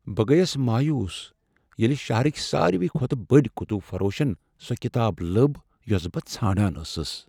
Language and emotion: Kashmiri, sad